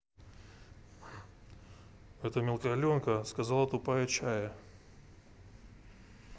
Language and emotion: Russian, neutral